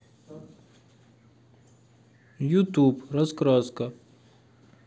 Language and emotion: Russian, neutral